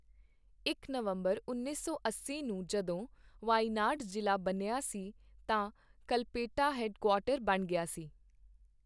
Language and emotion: Punjabi, neutral